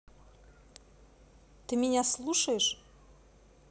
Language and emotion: Russian, neutral